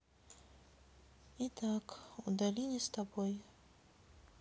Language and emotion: Russian, sad